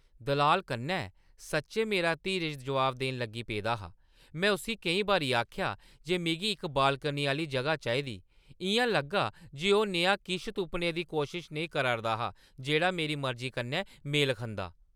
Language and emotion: Dogri, angry